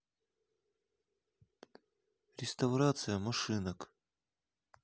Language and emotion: Russian, neutral